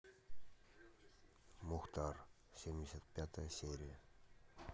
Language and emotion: Russian, neutral